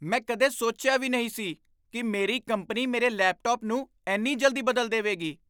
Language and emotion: Punjabi, surprised